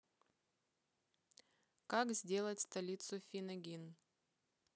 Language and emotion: Russian, neutral